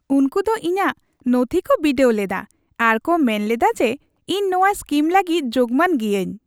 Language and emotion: Santali, happy